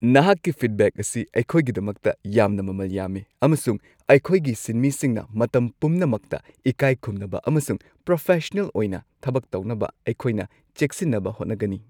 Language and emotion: Manipuri, happy